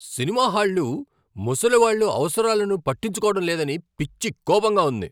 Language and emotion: Telugu, angry